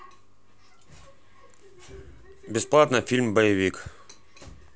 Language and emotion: Russian, neutral